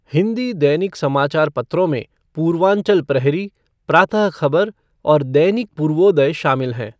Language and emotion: Hindi, neutral